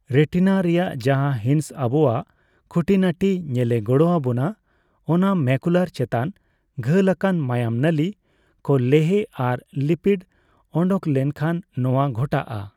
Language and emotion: Santali, neutral